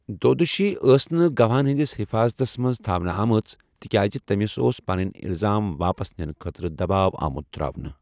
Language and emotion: Kashmiri, neutral